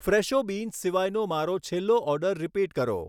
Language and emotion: Gujarati, neutral